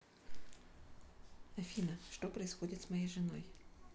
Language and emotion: Russian, neutral